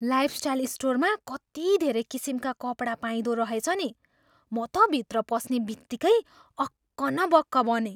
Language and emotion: Nepali, surprised